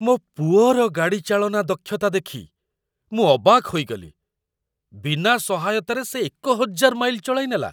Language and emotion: Odia, surprised